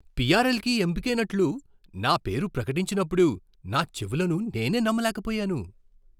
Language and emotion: Telugu, surprised